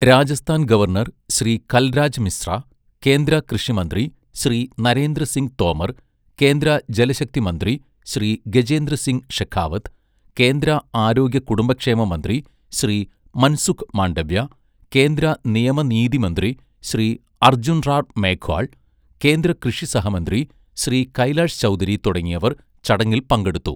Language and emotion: Malayalam, neutral